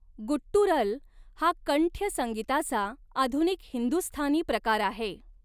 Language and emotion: Marathi, neutral